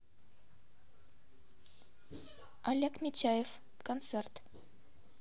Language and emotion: Russian, neutral